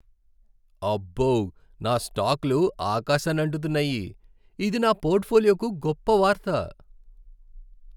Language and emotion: Telugu, happy